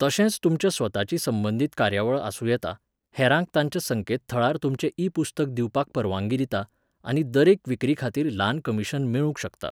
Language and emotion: Goan Konkani, neutral